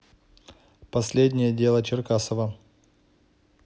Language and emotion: Russian, neutral